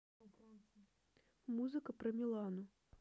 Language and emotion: Russian, neutral